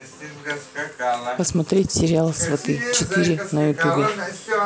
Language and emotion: Russian, neutral